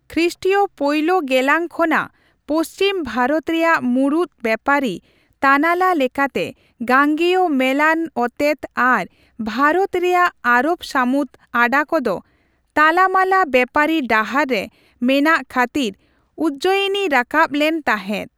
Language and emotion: Santali, neutral